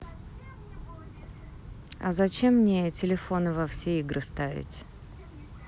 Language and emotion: Russian, neutral